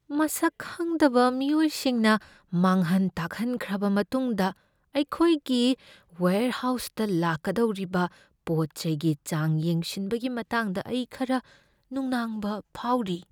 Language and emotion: Manipuri, fearful